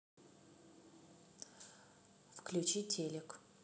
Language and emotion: Russian, neutral